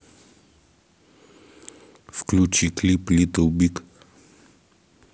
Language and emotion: Russian, neutral